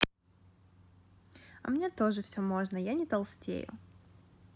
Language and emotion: Russian, positive